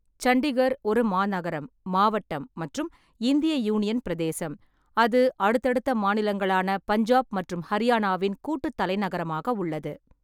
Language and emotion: Tamil, neutral